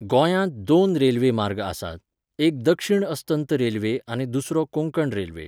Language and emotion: Goan Konkani, neutral